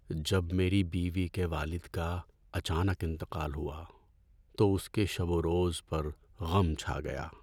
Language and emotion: Urdu, sad